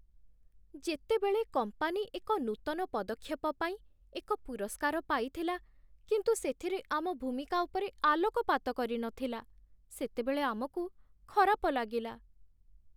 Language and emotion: Odia, sad